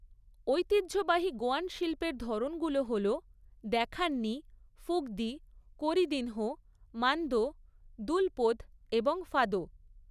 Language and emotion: Bengali, neutral